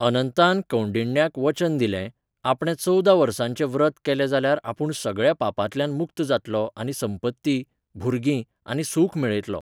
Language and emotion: Goan Konkani, neutral